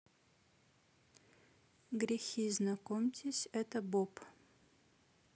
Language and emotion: Russian, neutral